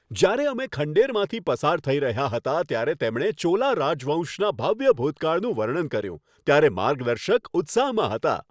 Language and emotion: Gujarati, happy